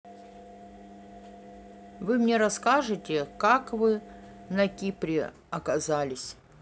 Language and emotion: Russian, neutral